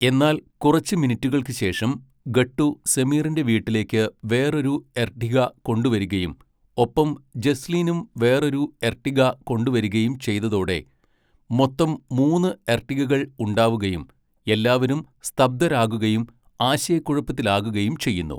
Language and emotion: Malayalam, neutral